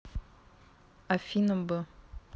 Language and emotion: Russian, neutral